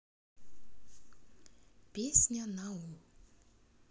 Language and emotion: Russian, neutral